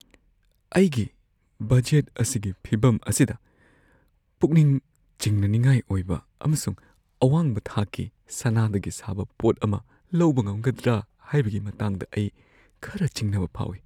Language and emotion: Manipuri, fearful